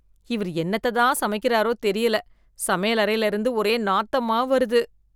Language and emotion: Tamil, disgusted